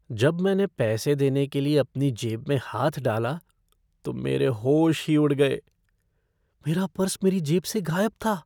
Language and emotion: Hindi, fearful